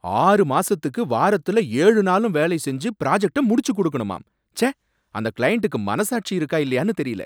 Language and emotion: Tamil, angry